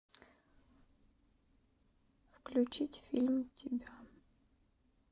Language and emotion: Russian, sad